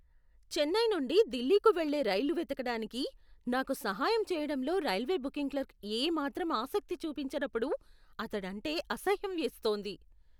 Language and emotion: Telugu, disgusted